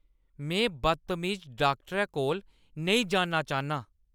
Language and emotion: Dogri, angry